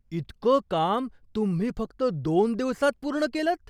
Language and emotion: Marathi, surprised